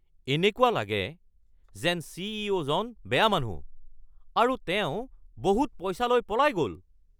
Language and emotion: Assamese, angry